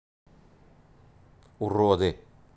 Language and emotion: Russian, neutral